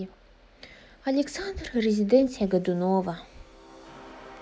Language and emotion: Russian, sad